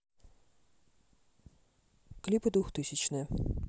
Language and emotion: Russian, neutral